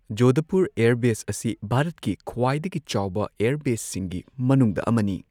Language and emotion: Manipuri, neutral